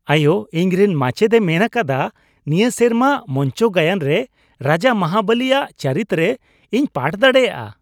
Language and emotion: Santali, happy